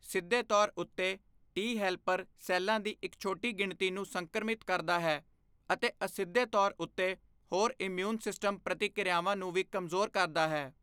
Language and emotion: Punjabi, neutral